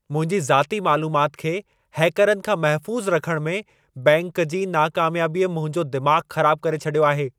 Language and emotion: Sindhi, angry